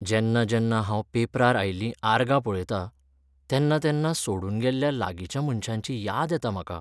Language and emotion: Goan Konkani, sad